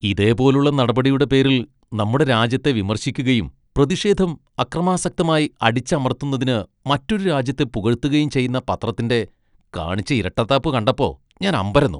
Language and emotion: Malayalam, disgusted